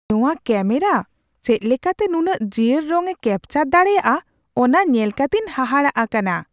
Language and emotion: Santali, surprised